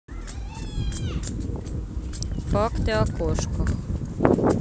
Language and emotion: Russian, neutral